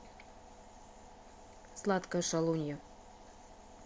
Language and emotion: Russian, neutral